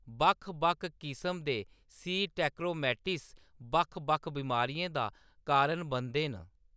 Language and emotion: Dogri, neutral